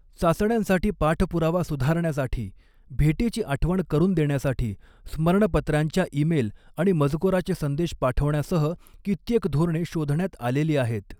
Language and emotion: Marathi, neutral